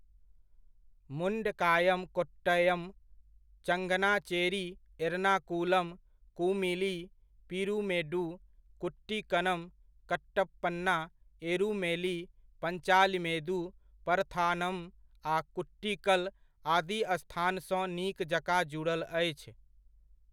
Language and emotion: Maithili, neutral